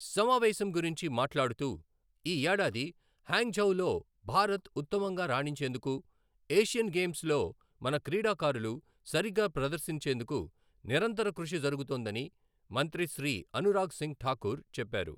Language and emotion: Telugu, neutral